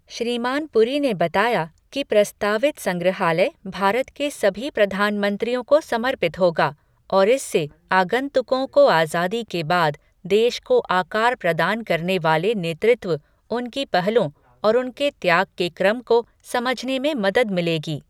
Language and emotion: Hindi, neutral